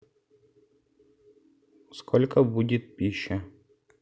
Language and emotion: Russian, neutral